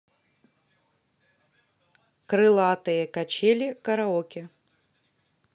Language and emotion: Russian, neutral